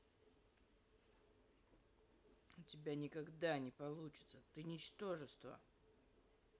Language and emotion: Russian, angry